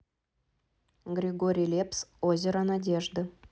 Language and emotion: Russian, neutral